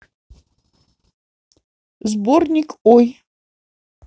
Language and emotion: Russian, neutral